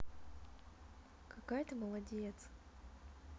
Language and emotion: Russian, positive